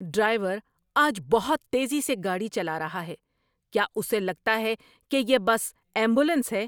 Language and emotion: Urdu, angry